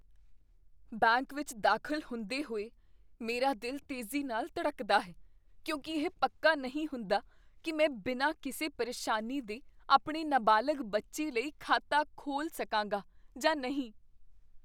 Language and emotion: Punjabi, fearful